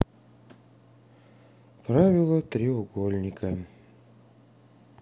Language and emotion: Russian, sad